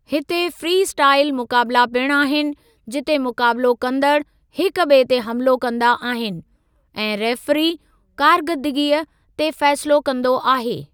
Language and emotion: Sindhi, neutral